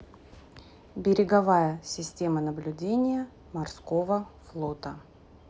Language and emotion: Russian, neutral